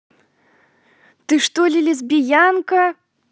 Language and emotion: Russian, neutral